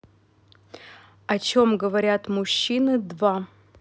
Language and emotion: Russian, neutral